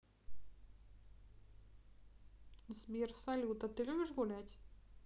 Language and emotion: Russian, neutral